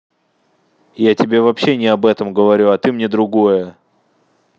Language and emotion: Russian, angry